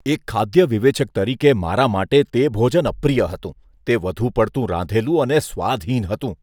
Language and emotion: Gujarati, disgusted